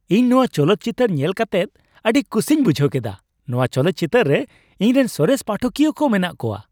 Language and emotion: Santali, happy